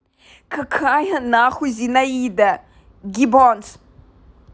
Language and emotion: Russian, angry